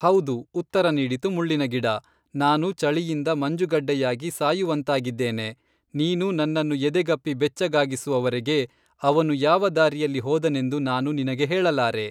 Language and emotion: Kannada, neutral